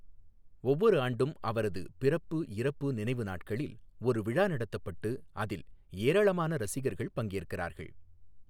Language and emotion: Tamil, neutral